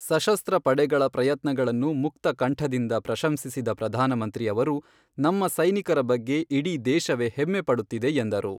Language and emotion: Kannada, neutral